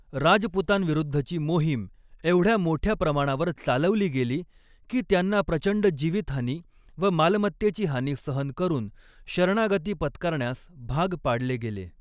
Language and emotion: Marathi, neutral